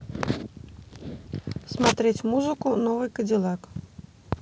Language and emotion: Russian, neutral